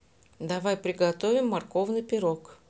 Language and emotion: Russian, neutral